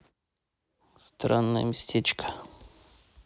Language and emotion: Russian, neutral